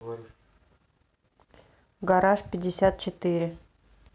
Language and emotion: Russian, neutral